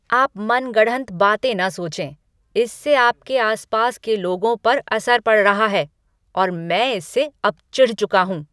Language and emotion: Hindi, angry